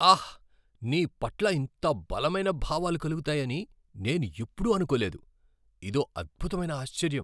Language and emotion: Telugu, surprised